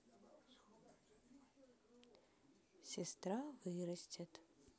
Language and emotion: Russian, neutral